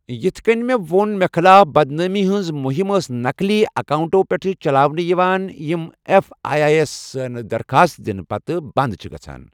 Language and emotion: Kashmiri, neutral